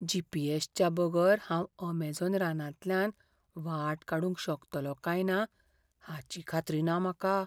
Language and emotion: Goan Konkani, fearful